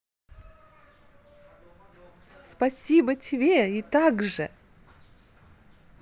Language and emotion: Russian, positive